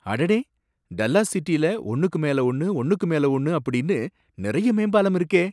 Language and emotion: Tamil, surprised